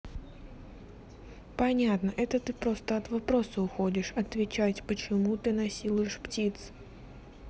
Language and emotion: Russian, neutral